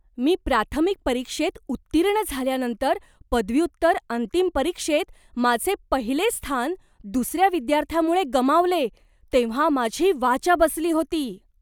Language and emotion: Marathi, surprised